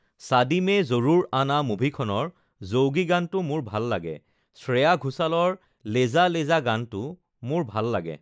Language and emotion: Assamese, neutral